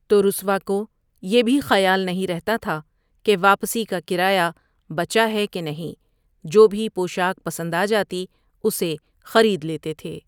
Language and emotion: Urdu, neutral